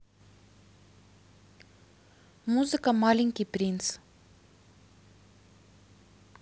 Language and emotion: Russian, neutral